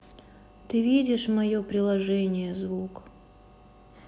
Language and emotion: Russian, sad